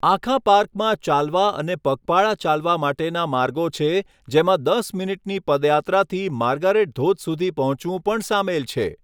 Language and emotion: Gujarati, neutral